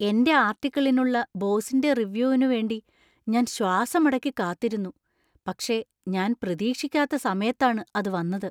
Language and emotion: Malayalam, surprised